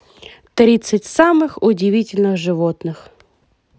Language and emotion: Russian, positive